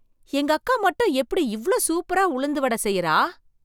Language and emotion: Tamil, surprised